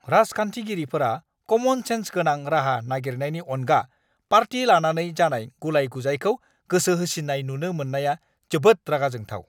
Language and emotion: Bodo, angry